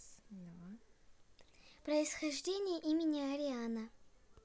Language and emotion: Russian, neutral